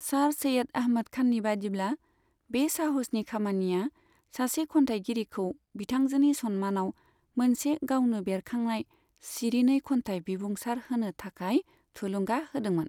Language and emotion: Bodo, neutral